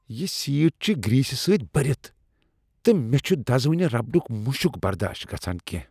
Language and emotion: Kashmiri, disgusted